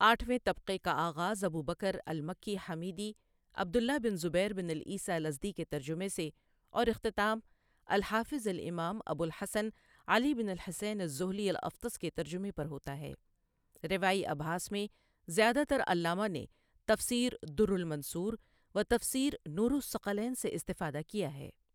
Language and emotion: Urdu, neutral